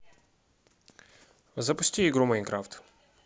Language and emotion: Russian, neutral